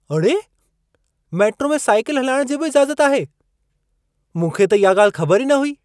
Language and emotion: Sindhi, surprised